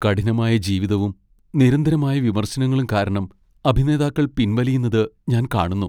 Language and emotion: Malayalam, sad